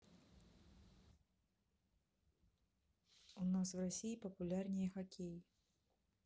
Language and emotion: Russian, neutral